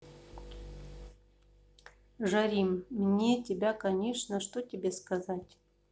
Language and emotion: Russian, neutral